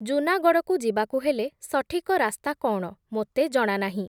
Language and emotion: Odia, neutral